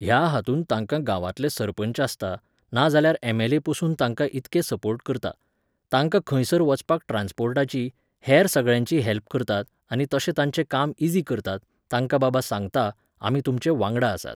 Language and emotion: Goan Konkani, neutral